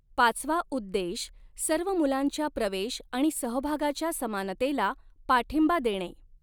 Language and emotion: Marathi, neutral